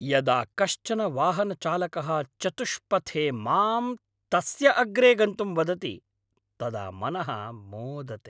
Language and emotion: Sanskrit, happy